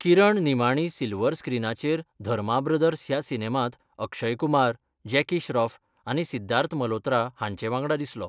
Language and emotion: Goan Konkani, neutral